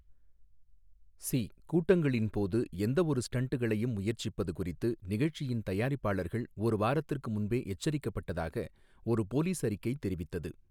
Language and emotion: Tamil, neutral